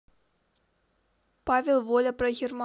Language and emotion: Russian, neutral